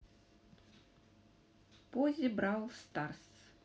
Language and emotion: Russian, neutral